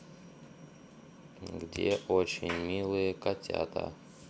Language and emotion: Russian, neutral